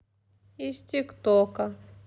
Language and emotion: Russian, sad